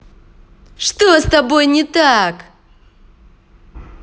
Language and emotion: Russian, angry